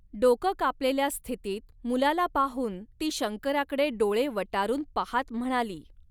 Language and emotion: Marathi, neutral